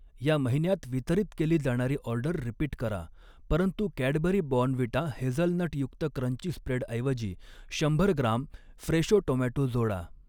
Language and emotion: Marathi, neutral